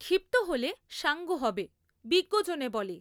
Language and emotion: Bengali, neutral